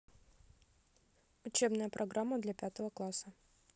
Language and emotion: Russian, neutral